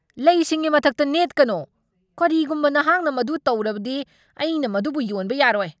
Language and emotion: Manipuri, angry